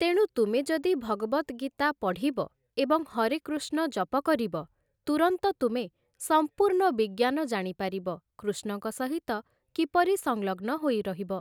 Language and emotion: Odia, neutral